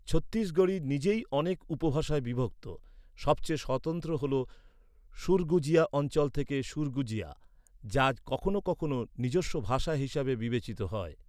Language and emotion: Bengali, neutral